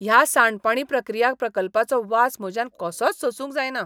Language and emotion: Goan Konkani, disgusted